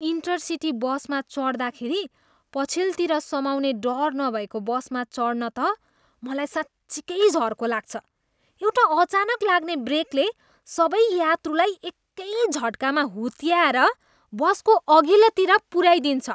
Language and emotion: Nepali, disgusted